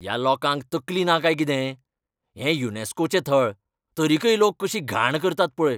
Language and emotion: Goan Konkani, angry